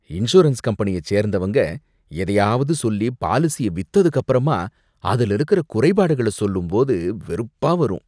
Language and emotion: Tamil, disgusted